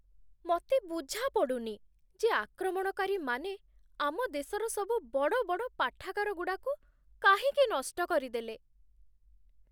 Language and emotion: Odia, sad